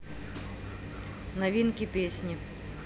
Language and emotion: Russian, neutral